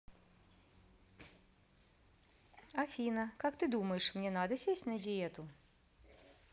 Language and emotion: Russian, neutral